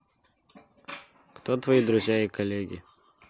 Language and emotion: Russian, neutral